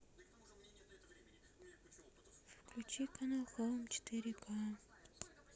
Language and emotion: Russian, sad